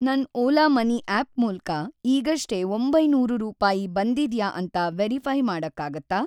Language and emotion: Kannada, neutral